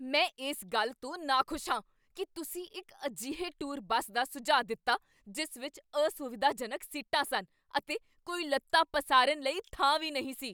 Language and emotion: Punjabi, angry